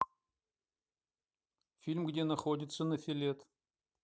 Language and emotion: Russian, neutral